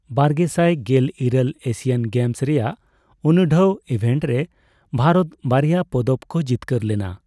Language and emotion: Santali, neutral